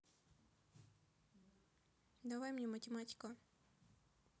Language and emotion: Russian, neutral